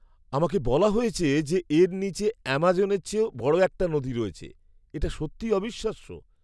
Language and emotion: Bengali, surprised